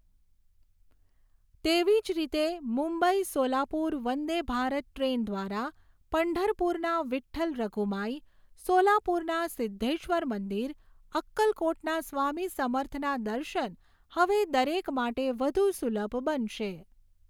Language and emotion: Gujarati, neutral